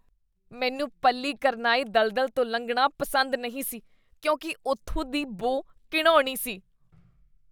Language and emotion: Punjabi, disgusted